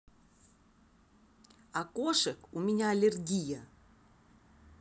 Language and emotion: Russian, angry